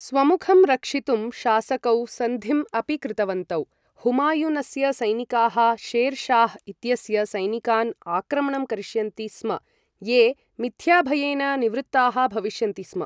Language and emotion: Sanskrit, neutral